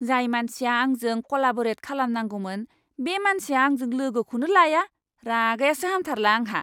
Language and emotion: Bodo, angry